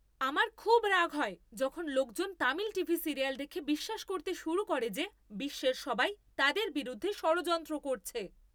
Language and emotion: Bengali, angry